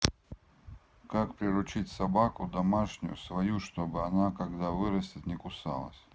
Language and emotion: Russian, neutral